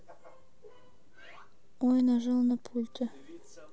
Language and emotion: Russian, neutral